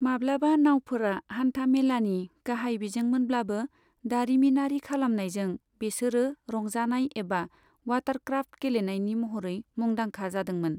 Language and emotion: Bodo, neutral